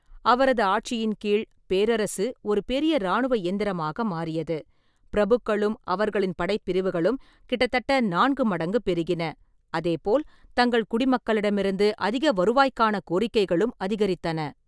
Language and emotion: Tamil, neutral